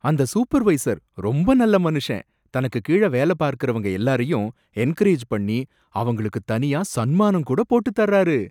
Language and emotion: Tamil, surprised